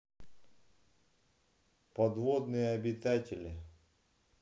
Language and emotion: Russian, neutral